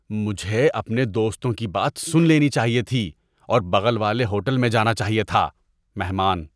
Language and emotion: Urdu, disgusted